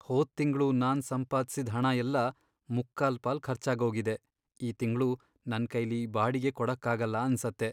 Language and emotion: Kannada, sad